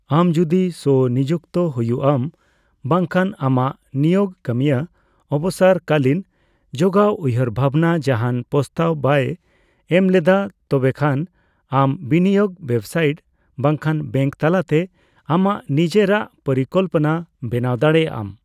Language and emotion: Santali, neutral